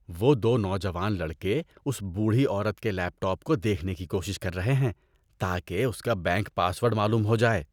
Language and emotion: Urdu, disgusted